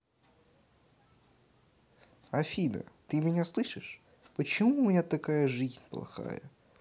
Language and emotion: Russian, neutral